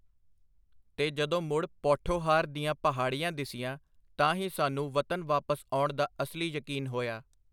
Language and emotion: Punjabi, neutral